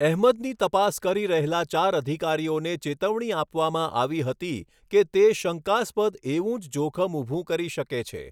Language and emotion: Gujarati, neutral